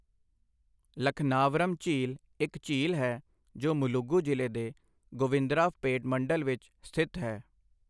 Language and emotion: Punjabi, neutral